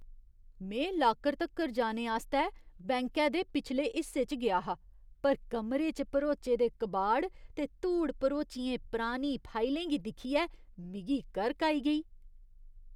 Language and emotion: Dogri, disgusted